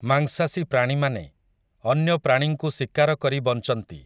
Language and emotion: Odia, neutral